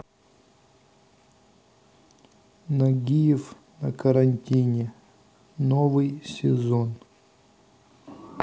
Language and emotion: Russian, neutral